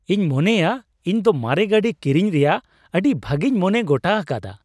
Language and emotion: Santali, happy